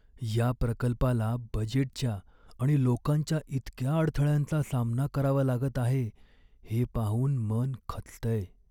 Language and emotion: Marathi, sad